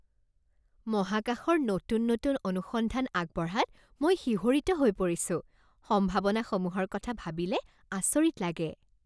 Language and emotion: Assamese, happy